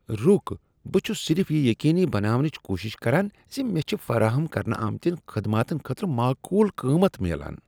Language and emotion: Kashmiri, disgusted